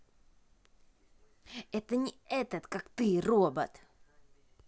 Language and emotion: Russian, angry